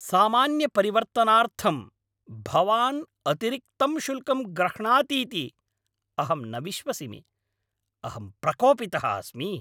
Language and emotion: Sanskrit, angry